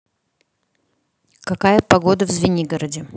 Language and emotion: Russian, neutral